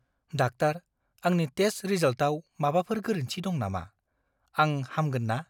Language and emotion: Bodo, fearful